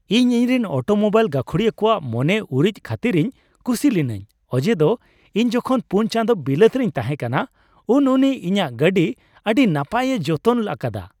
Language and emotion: Santali, happy